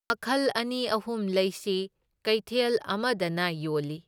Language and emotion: Manipuri, neutral